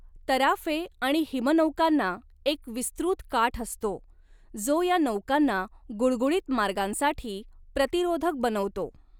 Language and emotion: Marathi, neutral